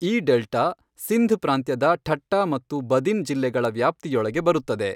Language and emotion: Kannada, neutral